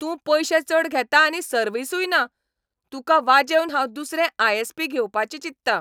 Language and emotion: Goan Konkani, angry